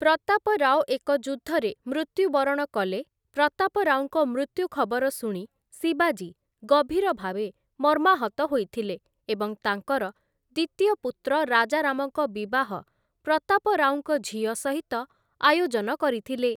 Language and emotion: Odia, neutral